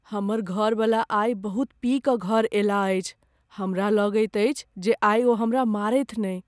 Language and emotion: Maithili, fearful